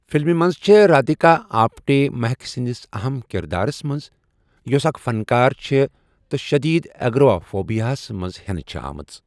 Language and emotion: Kashmiri, neutral